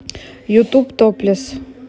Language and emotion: Russian, neutral